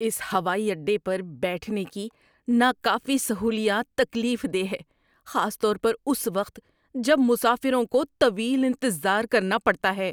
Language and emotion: Urdu, disgusted